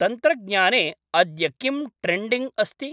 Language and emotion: Sanskrit, neutral